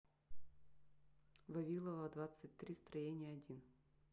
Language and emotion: Russian, neutral